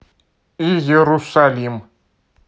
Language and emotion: Russian, neutral